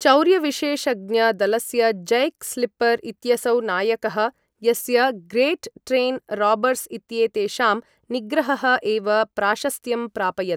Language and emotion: Sanskrit, neutral